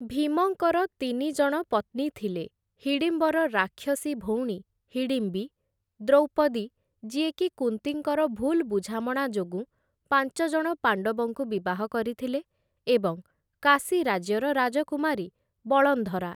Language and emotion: Odia, neutral